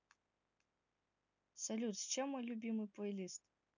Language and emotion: Russian, neutral